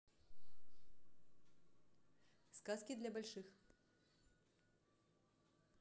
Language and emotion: Russian, neutral